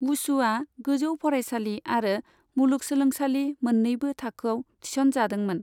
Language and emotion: Bodo, neutral